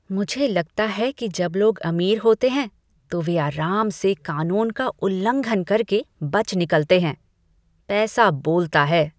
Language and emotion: Hindi, disgusted